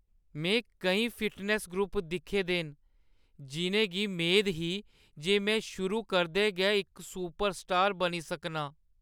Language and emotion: Dogri, sad